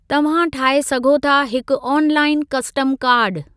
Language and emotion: Sindhi, neutral